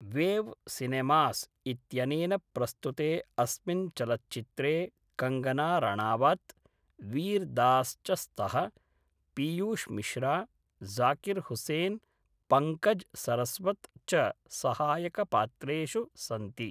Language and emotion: Sanskrit, neutral